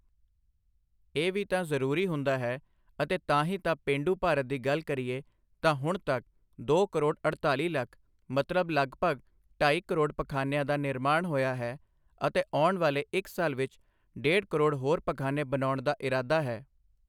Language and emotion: Punjabi, neutral